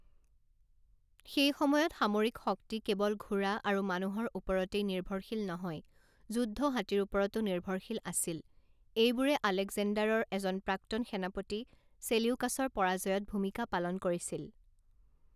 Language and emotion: Assamese, neutral